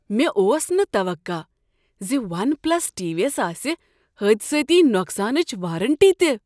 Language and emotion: Kashmiri, surprised